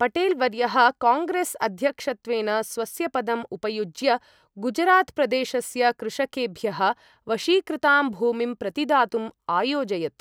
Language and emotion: Sanskrit, neutral